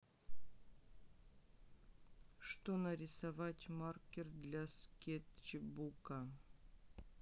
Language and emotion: Russian, neutral